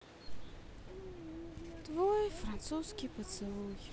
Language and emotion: Russian, sad